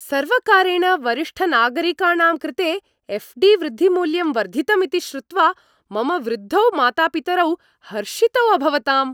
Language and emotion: Sanskrit, happy